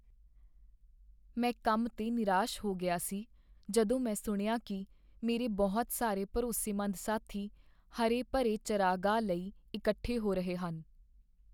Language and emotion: Punjabi, sad